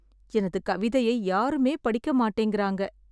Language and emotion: Tamil, sad